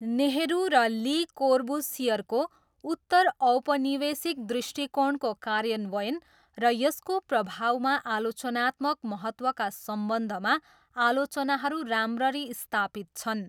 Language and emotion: Nepali, neutral